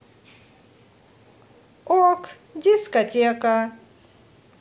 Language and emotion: Russian, positive